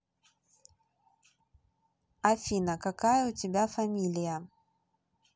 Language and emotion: Russian, neutral